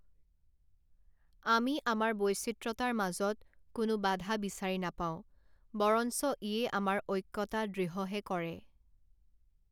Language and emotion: Assamese, neutral